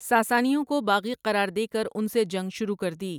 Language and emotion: Urdu, neutral